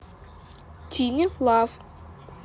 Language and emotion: Russian, neutral